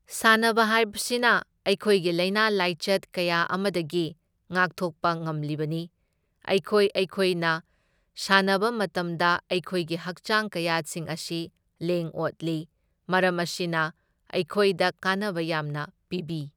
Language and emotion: Manipuri, neutral